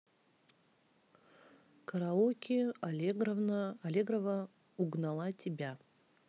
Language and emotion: Russian, neutral